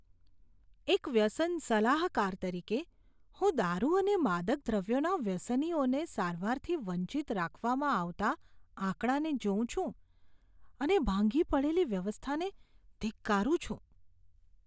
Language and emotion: Gujarati, disgusted